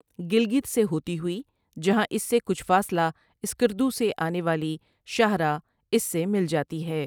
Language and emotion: Urdu, neutral